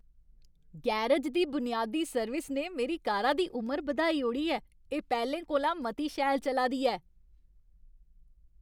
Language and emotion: Dogri, happy